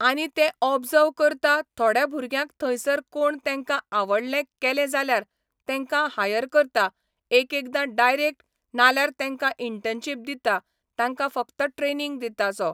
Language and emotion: Goan Konkani, neutral